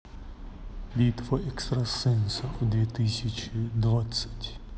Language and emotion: Russian, neutral